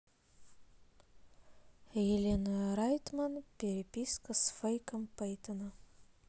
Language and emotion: Russian, neutral